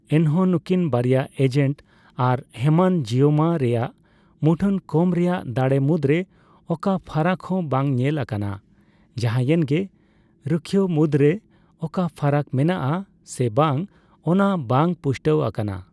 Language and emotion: Santali, neutral